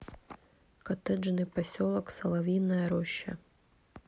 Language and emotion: Russian, neutral